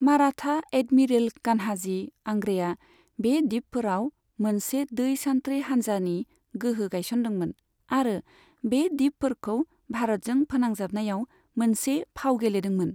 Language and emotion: Bodo, neutral